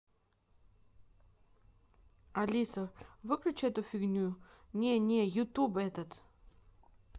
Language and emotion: Russian, neutral